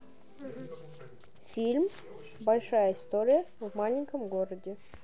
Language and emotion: Russian, neutral